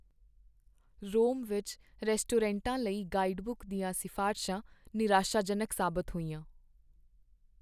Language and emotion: Punjabi, sad